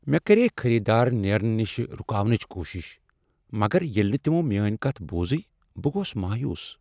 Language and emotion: Kashmiri, sad